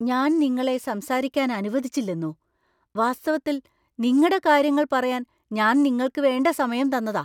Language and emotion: Malayalam, surprised